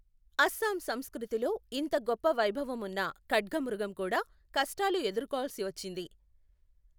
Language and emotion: Telugu, neutral